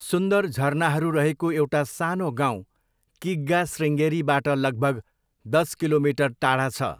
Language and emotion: Nepali, neutral